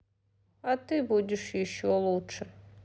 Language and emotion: Russian, sad